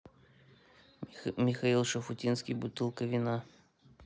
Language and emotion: Russian, neutral